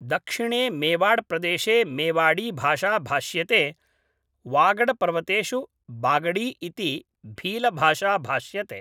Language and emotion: Sanskrit, neutral